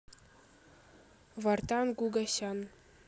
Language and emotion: Russian, neutral